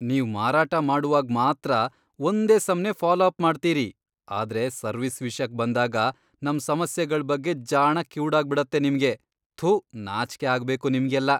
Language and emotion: Kannada, disgusted